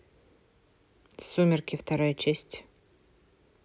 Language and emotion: Russian, neutral